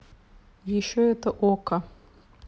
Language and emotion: Russian, neutral